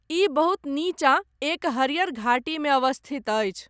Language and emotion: Maithili, neutral